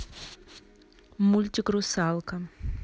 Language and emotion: Russian, neutral